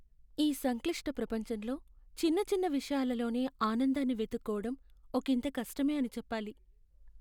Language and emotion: Telugu, sad